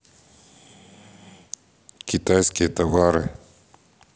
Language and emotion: Russian, neutral